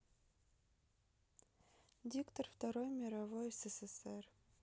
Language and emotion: Russian, neutral